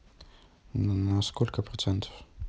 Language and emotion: Russian, neutral